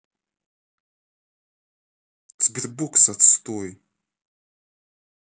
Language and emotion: Russian, angry